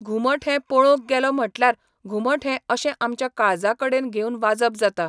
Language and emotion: Goan Konkani, neutral